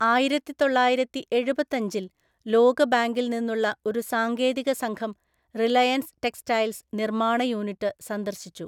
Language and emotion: Malayalam, neutral